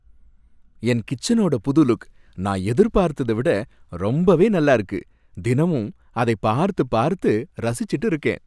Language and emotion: Tamil, happy